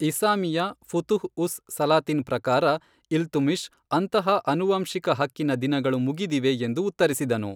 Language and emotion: Kannada, neutral